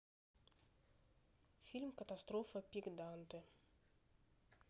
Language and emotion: Russian, neutral